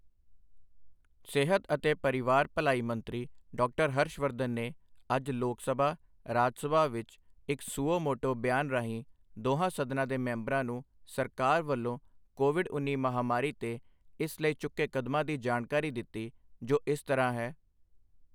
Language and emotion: Punjabi, neutral